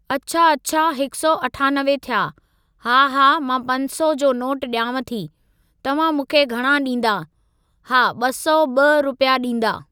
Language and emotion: Sindhi, neutral